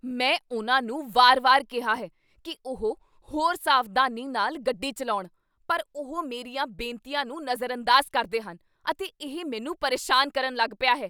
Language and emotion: Punjabi, angry